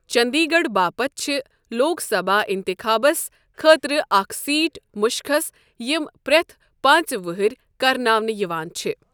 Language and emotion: Kashmiri, neutral